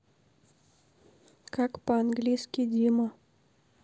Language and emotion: Russian, neutral